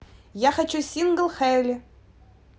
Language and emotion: Russian, positive